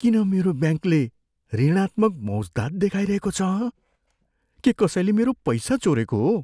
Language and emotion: Nepali, fearful